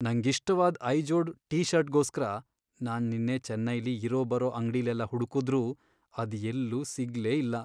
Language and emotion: Kannada, sad